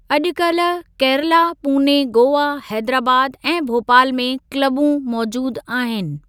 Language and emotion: Sindhi, neutral